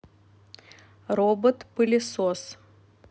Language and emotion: Russian, neutral